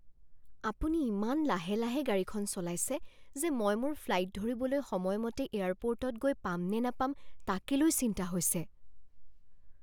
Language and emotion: Assamese, fearful